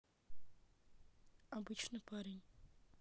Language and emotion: Russian, neutral